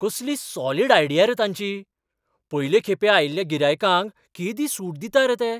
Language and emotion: Goan Konkani, surprised